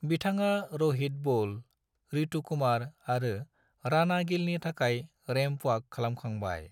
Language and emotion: Bodo, neutral